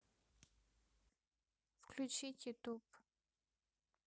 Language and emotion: Russian, neutral